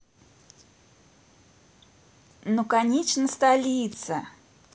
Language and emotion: Russian, positive